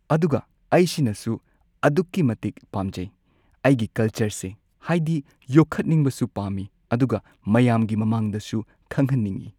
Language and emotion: Manipuri, neutral